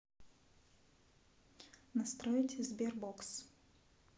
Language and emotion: Russian, neutral